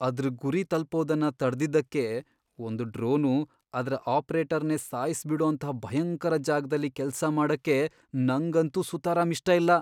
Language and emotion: Kannada, fearful